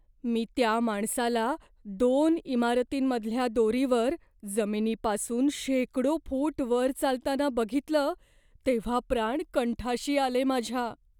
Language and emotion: Marathi, fearful